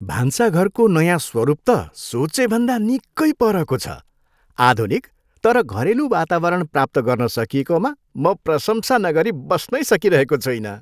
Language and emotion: Nepali, happy